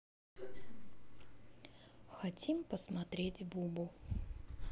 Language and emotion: Russian, neutral